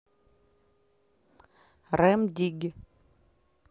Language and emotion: Russian, neutral